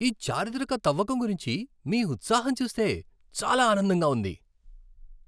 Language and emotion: Telugu, happy